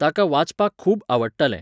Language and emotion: Goan Konkani, neutral